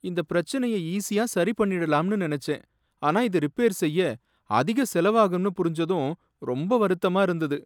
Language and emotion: Tamil, sad